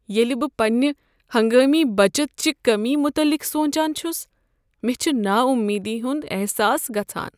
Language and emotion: Kashmiri, sad